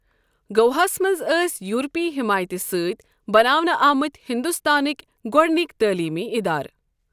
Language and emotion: Kashmiri, neutral